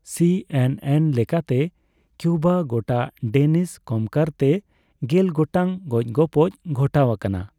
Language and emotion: Santali, neutral